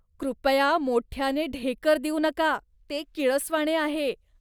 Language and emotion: Marathi, disgusted